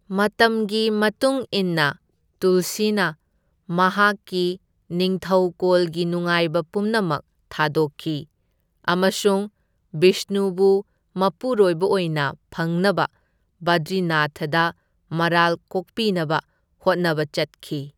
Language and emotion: Manipuri, neutral